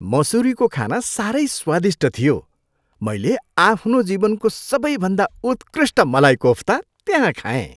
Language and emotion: Nepali, happy